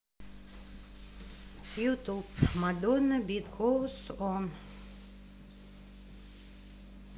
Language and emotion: Russian, neutral